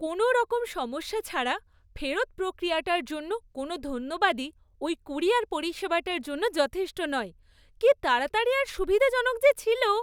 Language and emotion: Bengali, happy